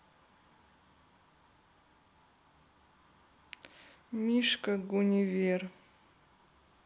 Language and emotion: Russian, sad